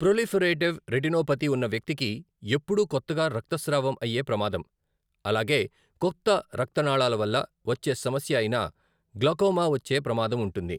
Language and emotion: Telugu, neutral